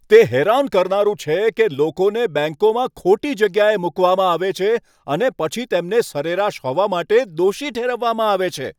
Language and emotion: Gujarati, angry